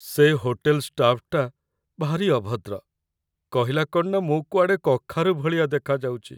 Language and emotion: Odia, sad